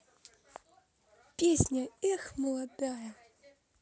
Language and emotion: Russian, positive